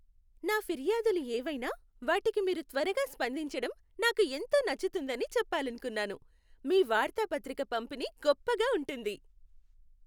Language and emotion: Telugu, happy